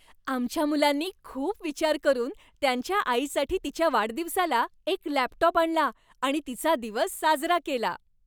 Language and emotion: Marathi, happy